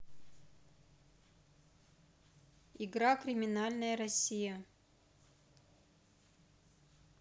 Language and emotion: Russian, neutral